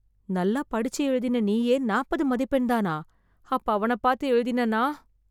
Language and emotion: Tamil, fearful